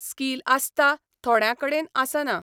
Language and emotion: Goan Konkani, neutral